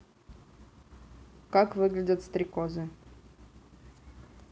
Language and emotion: Russian, neutral